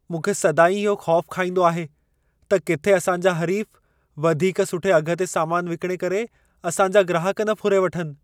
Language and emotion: Sindhi, fearful